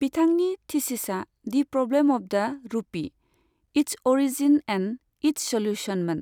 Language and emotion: Bodo, neutral